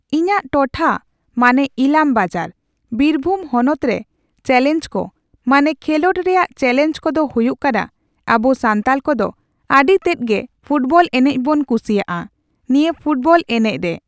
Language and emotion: Santali, neutral